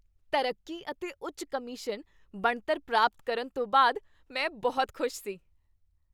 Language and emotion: Punjabi, happy